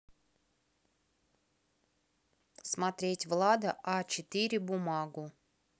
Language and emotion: Russian, neutral